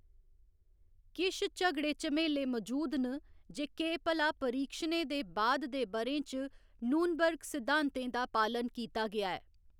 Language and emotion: Dogri, neutral